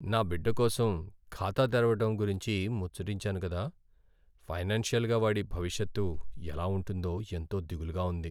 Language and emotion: Telugu, sad